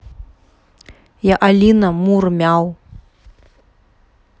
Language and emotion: Russian, neutral